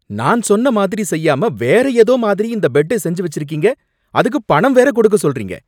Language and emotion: Tamil, angry